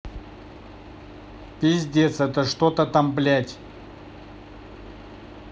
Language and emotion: Russian, angry